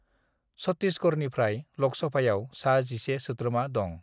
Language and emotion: Bodo, neutral